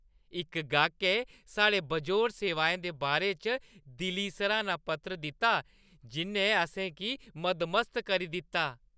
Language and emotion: Dogri, happy